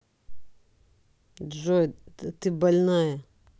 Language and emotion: Russian, angry